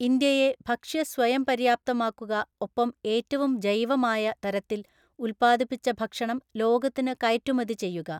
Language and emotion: Malayalam, neutral